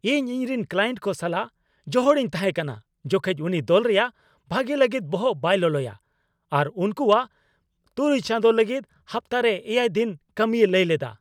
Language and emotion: Santali, angry